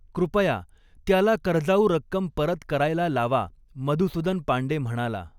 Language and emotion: Marathi, neutral